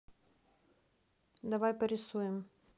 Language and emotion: Russian, neutral